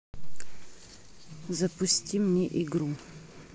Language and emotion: Russian, neutral